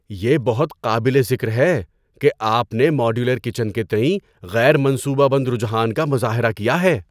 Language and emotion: Urdu, surprised